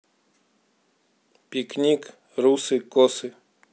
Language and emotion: Russian, neutral